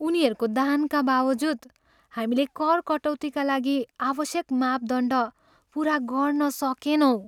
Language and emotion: Nepali, sad